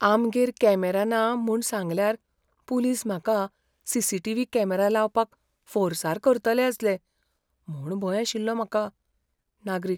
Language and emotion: Goan Konkani, fearful